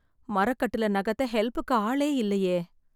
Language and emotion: Tamil, sad